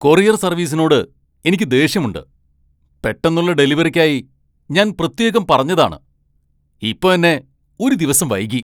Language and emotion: Malayalam, angry